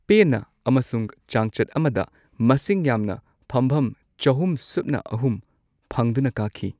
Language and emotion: Manipuri, neutral